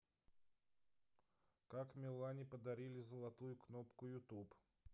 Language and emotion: Russian, neutral